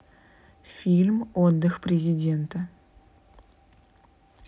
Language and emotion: Russian, neutral